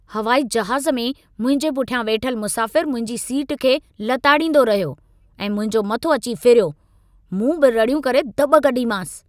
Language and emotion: Sindhi, angry